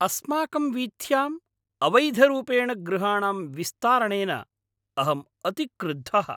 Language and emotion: Sanskrit, angry